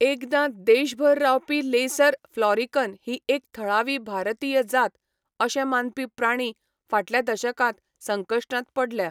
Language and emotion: Goan Konkani, neutral